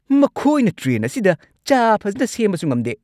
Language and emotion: Manipuri, angry